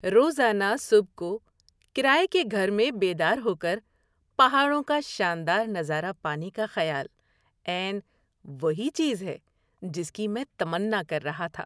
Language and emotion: Urdu, happy